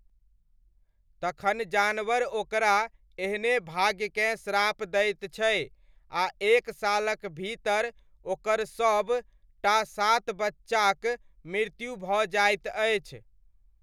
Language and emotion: Maithili, neutral